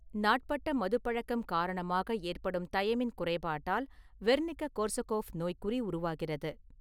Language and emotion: Tamil, neutral